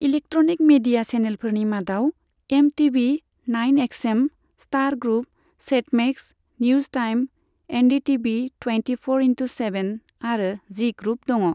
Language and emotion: Bodo, neutral